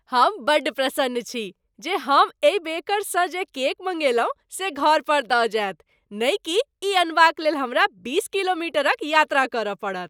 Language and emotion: Maithili, happy